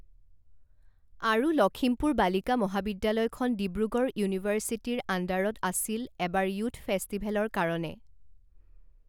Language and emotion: Assamese, neutral